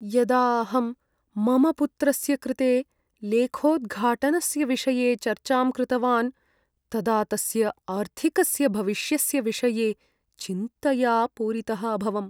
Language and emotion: Sanskrit, sad